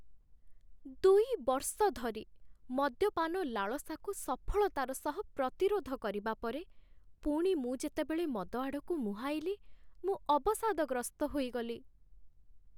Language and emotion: Odia, sad